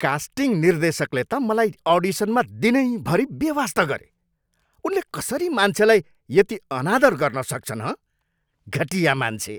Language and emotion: Nepali, angry